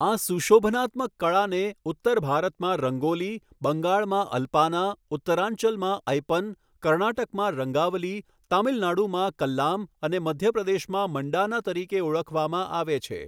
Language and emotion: Gujarati, neutral